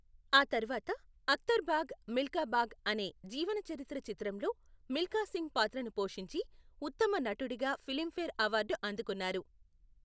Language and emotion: Telugu, neutral